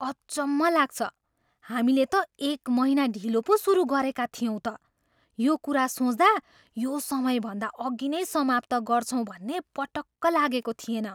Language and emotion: Nepali, surprised